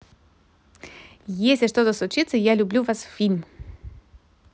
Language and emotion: Russian, positive